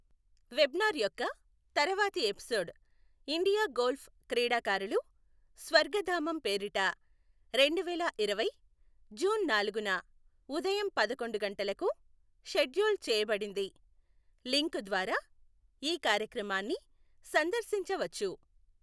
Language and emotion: Telugu, neutral